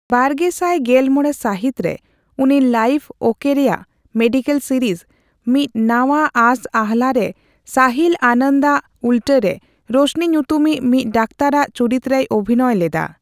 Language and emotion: Santali, neutral